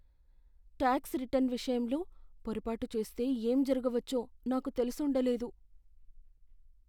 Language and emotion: Telugu, fearful